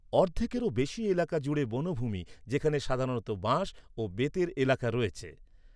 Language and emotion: Bengali, neutral